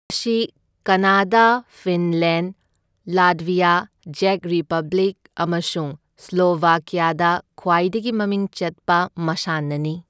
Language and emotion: Manipuri, neutral